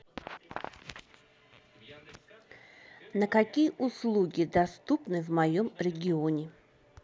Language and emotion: Russian, neutral